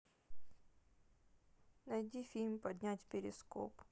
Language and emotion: Russian, sad